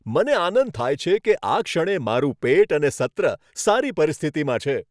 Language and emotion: Gujarati, happy